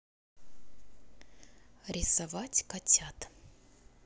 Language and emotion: Russian, neutral